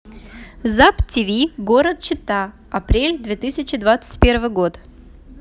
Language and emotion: Russian, neutral